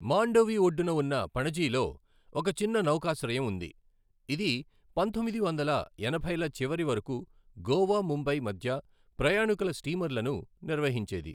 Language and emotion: Telugu, neutral